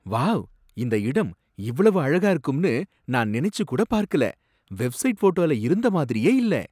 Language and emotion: Tamil, surprised